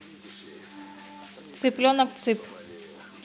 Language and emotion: Russian, neutral